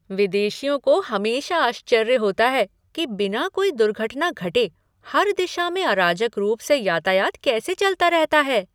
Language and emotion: Hindi, surprised